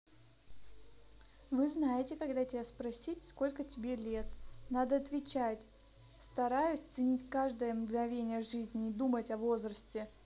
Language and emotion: Russian, neutral